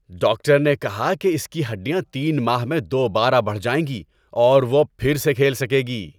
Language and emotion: Urdu, happy